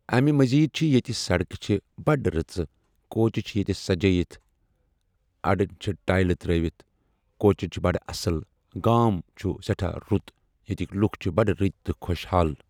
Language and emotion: Kashmiri, neutral